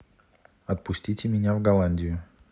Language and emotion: Russian, neutral